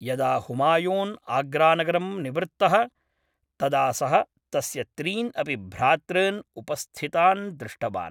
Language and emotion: Sanskrit, neutral